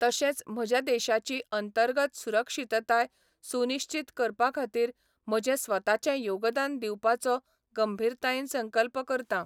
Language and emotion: Goan Konkani, neutral